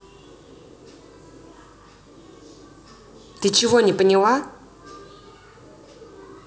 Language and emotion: Russian, angry